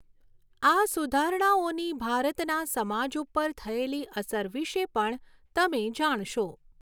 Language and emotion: Gujarati, neutral